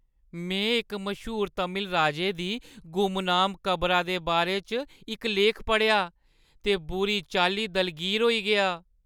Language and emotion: Dogri, sad